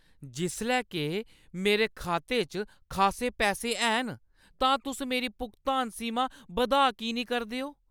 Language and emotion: Dogri, angry